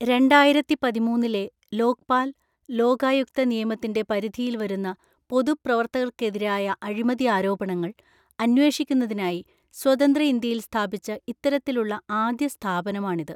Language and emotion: Malayalam, neutral